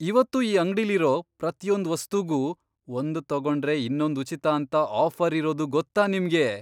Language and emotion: Kannada, surprised